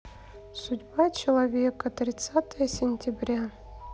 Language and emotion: Russian, sad